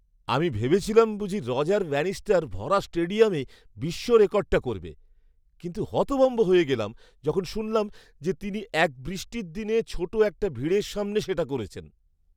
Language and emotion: Bengali, surprised